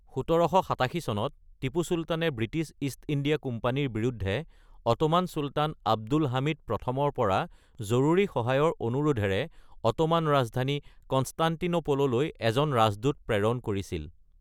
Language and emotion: Assamese, neutral